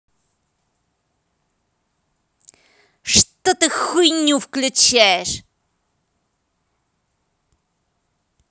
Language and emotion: Russian, angry